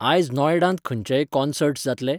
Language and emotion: Goan Konkani, neutral